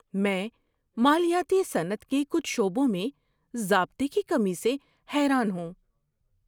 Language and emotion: Urdu, surprised